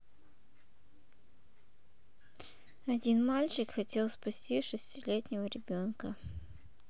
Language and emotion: Russian, neutral